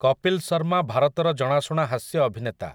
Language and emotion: Odia, neutral